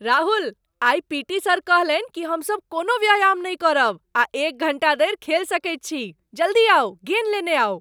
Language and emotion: Maithili, surprised